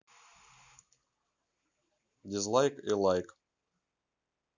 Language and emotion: Russian, neutral